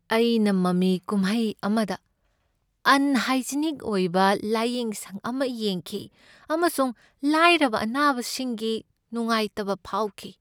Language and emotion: Manipuri, sad